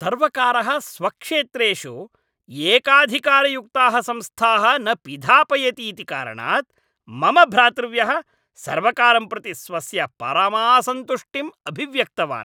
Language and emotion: Sanskrit, angry